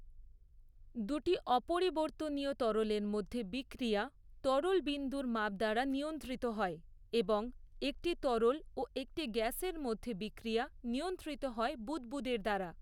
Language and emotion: Bengali, neutral